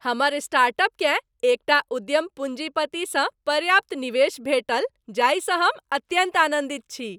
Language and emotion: Maithili, happy